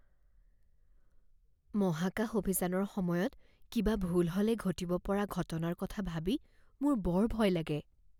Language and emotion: Assamese, fearful